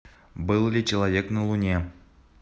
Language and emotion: Russian, neutral